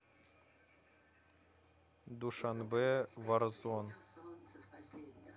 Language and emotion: Russian, neutral